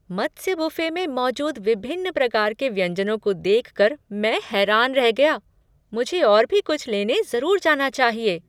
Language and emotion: Hindi, surprised